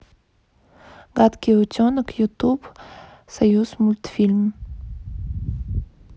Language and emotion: Russian, neutral